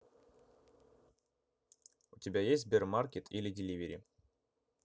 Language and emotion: Russian, neutral